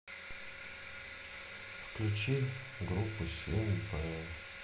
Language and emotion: Russian, sad